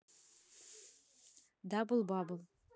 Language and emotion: Russian, neutral